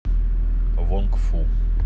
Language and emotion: Russian, neutral